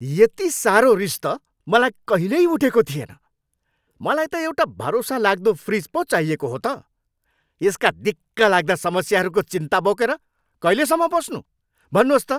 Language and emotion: Nepali, angry